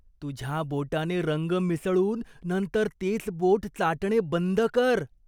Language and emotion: Marathi, disgusted